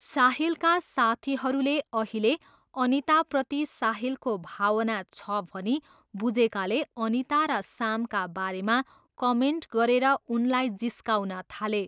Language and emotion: Nepali, neutral